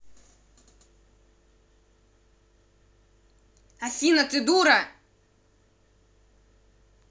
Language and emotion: Russian, angry